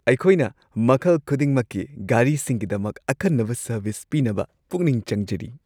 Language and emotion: Manipuri, happy